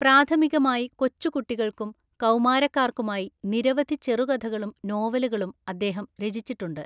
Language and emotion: Malayalam, neutral